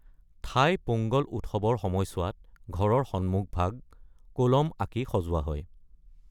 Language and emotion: Assamese, neutral